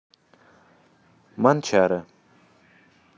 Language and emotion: Russian, neutral